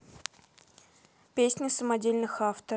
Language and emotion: Russian, neutral